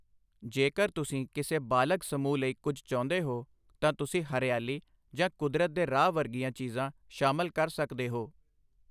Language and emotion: Punjabi, neutral